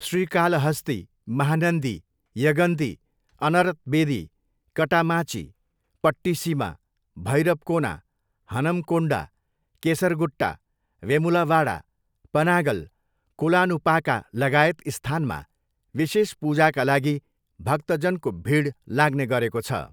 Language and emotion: Nepali, neutral